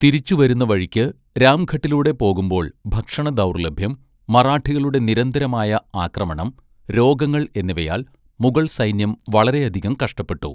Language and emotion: Malayalam, neutral